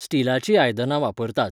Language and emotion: Goan Konkani, neutral